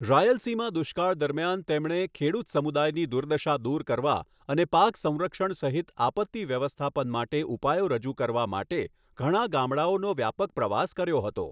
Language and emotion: Gujarati, neutral